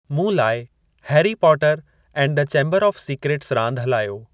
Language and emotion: Sindhi, neutral